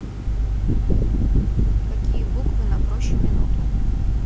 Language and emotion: Russian, neutral